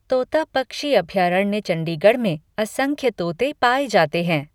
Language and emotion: Hindi, neutral